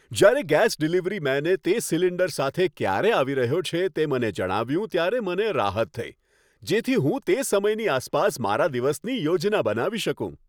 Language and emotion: Gujarati, happy